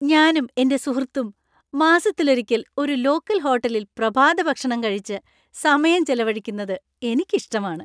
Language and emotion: Malayalam, happy